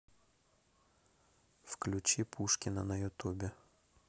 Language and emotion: Russian, neutral